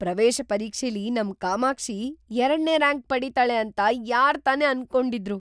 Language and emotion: Kannada, surprised